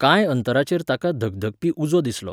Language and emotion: Goan Konkani, neutral